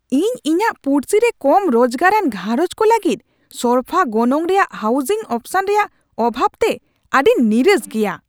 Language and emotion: Santali, angry